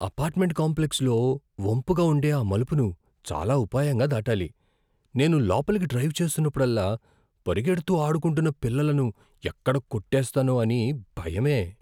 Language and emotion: Telugu, fearful